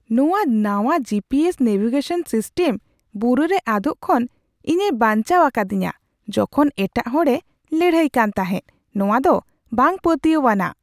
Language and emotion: Santali, surprised